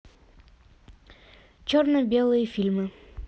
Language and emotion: Russian, neutral